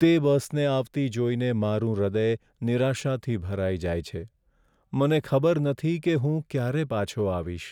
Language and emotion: Gujarati, sad